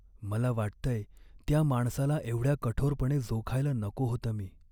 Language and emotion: Marathi, sad